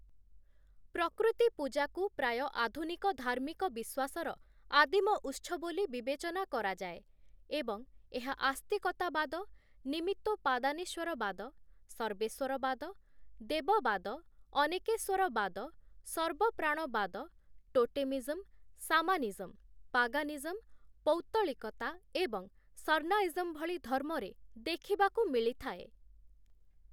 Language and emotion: Odia, neutral